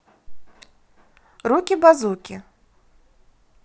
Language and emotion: Russian, positive